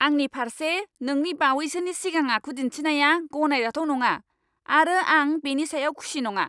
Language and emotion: Bodo, angry